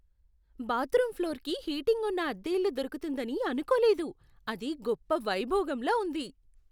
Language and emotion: Telugu, surprised